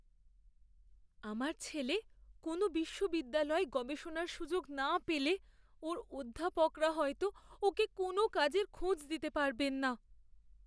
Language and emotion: Bengali, fearful